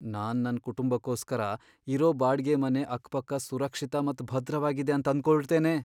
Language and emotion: Kannada, fearful